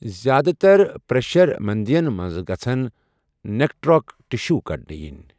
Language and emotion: Kashmiri, neutral